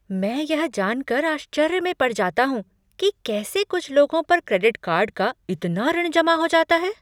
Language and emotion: Hindi, surprised